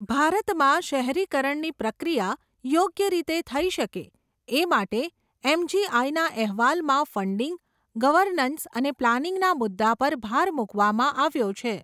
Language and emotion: Gujarati, neutral